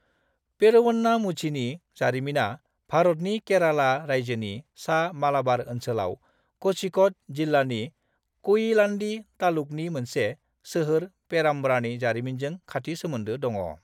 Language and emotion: Bodo, neutral